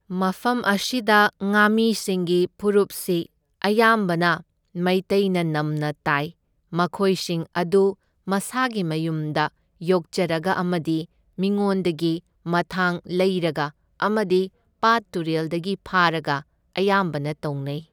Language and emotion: Manipuri, neutral